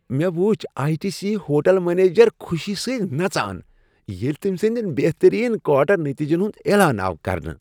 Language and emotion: Kashmiri, happy